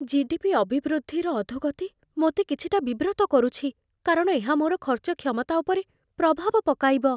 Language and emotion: Odia, fearful